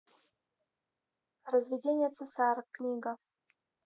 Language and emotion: Russian, neutral